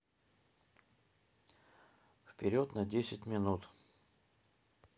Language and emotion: Russian, neutral